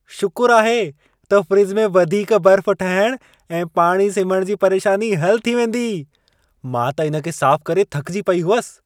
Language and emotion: Sindhi, happy